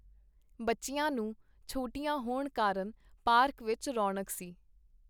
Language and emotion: Punjabi, neutral